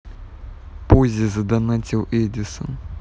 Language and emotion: Russian, neutral